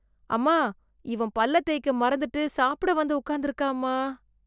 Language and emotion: Tamil, disgusted